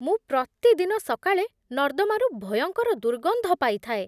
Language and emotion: Odia, disgusted